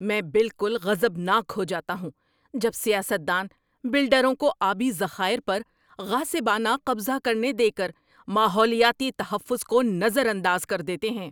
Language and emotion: Urdu, angry